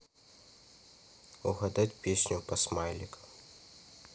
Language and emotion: Russian, neutral